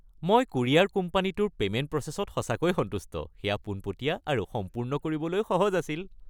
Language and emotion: Assamese, happy